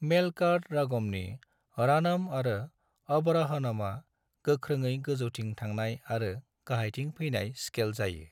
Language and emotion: Bodo, neutral